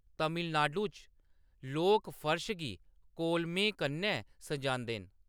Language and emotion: Dogri, neutral